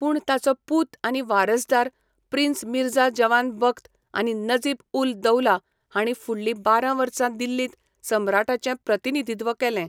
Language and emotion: Goan Konkani, neutral